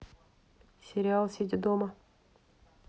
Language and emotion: Russian, neutral